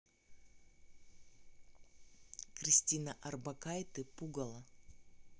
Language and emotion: Russian, neutral